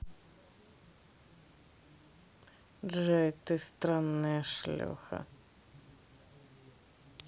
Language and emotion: Russian, neutral